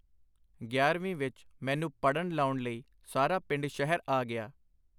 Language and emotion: Punjabi, neutral